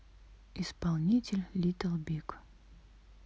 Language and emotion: Russian, neutral